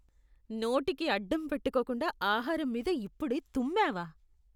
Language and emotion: Telugu, disgusted